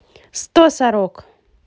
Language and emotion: Russian, positive